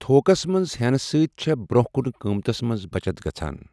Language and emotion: Kashmiri, neutral